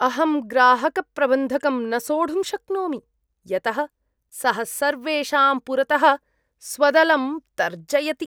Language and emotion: Sanskrit, disgusted